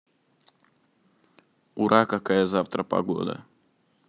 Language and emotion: Russian, neutral